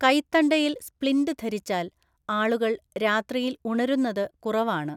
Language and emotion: Malayalam, neutral